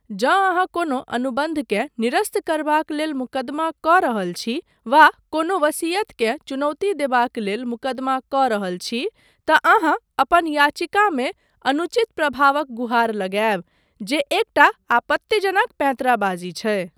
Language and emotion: Maithili, neutral